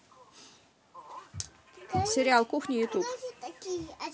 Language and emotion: Russian, neutral